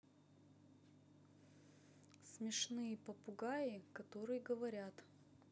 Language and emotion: Russian, neutral